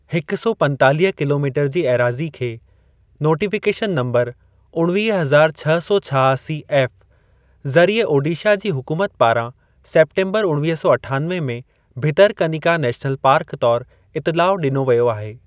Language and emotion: Sindhi, neutral